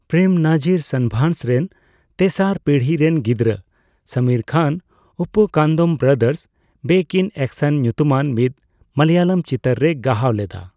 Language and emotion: Santali, neutral